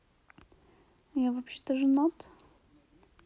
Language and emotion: Russian, neutral